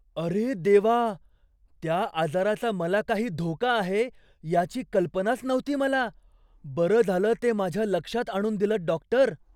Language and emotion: Marathi, surprised